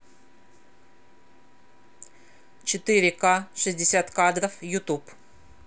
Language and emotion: Russian, positive